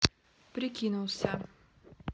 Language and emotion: Russian, neutral